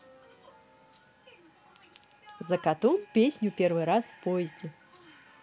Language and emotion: Russian, positive